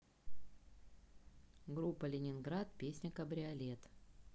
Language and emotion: Russian, neutral